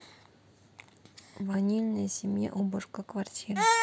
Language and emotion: Russian, neutral